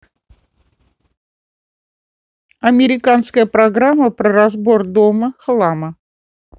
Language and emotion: Russian, neutral